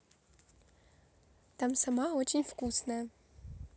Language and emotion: Russian, positive